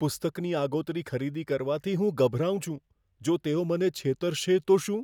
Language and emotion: Gujarati, fearful